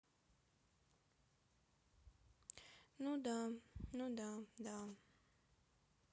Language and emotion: Russian, sad